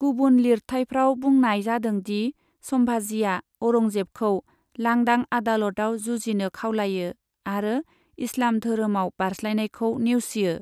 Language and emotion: Bodo, neutral